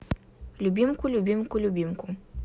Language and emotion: Russian, neutral